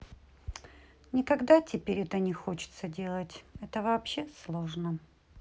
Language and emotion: Russian, sad